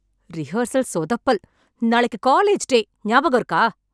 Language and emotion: Tamil, angry